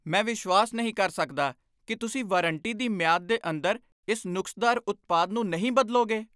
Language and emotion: Punjabi, angry